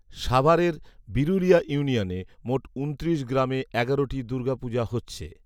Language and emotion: Bengali, neutral